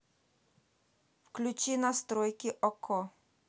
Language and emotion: Russian, neutral